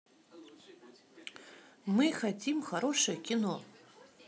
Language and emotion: Russian, positive